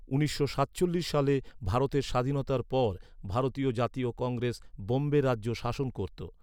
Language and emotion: Bengali, neutral